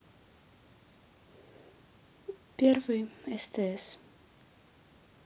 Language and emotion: Russian, neutral